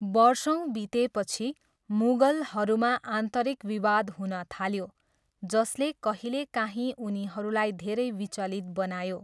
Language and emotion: Nepali, neutral